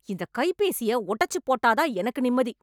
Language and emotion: Tamil, angry